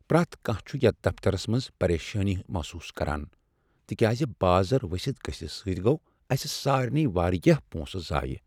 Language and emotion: Kashmiri, sad